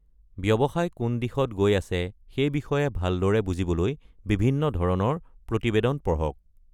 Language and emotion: Assamese, neutral